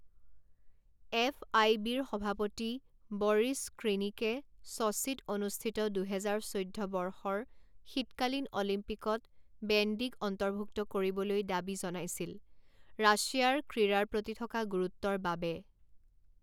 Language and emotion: Assamese, neutral